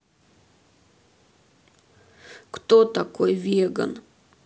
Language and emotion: Russian, sad